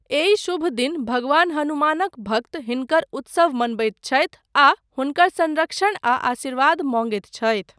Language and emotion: Maithili, neutral